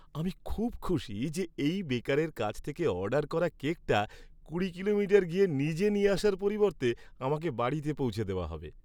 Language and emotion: Bengali, happy